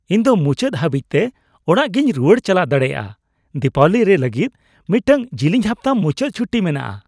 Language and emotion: Santali, happy